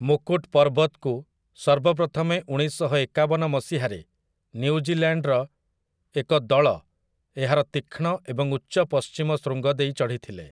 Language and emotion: Odia, neutral